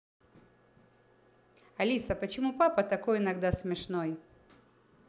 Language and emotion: Russian, positive